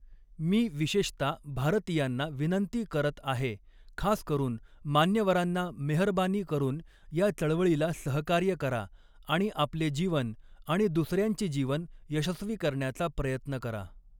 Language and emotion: Marathi, neutral